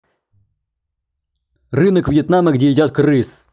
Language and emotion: Russian, neutral